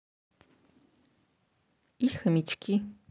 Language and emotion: Russian, neutral